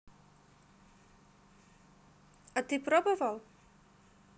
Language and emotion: Russian, neutral